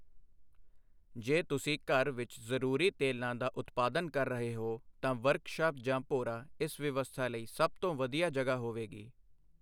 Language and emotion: Punjabi, neutral